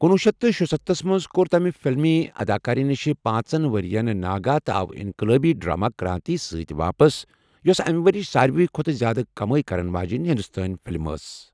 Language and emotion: Kashmiri, neutral